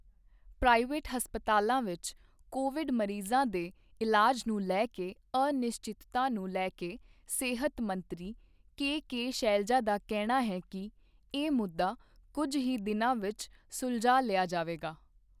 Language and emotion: Punjabi, neutral